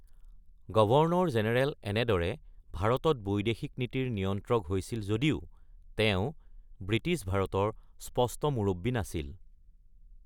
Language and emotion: Assamese, neutral